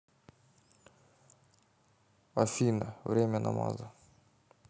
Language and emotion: Russian, neutral